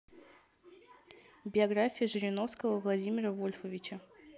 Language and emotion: Russian, neutral